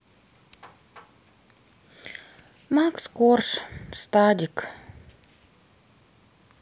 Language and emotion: Russian, sad